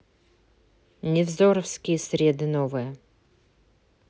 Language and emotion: Russian, neutral